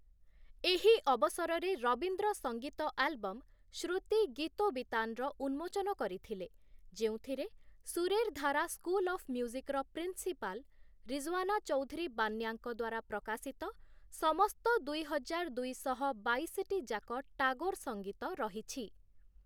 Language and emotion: Odia, neutral